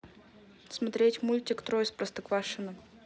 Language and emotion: Russian, neutral